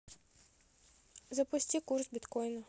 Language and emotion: Russian, neutral